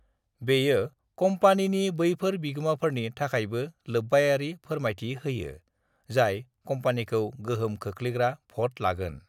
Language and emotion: Bodo, neutral